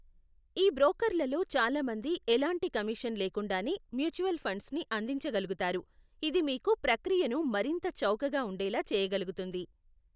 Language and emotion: Telugu, neutral